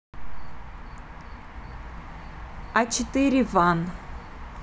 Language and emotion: Russian, neutral